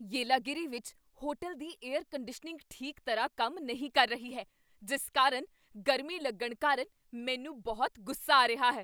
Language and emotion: Punjabi, angry